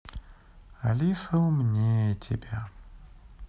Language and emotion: Russian, sad